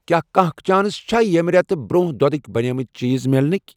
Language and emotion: Kashmiri, neutral